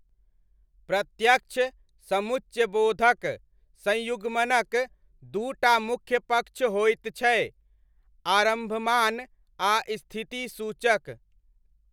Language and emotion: Maithili, neutral